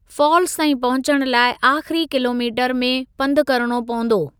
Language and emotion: Sindhi, neutral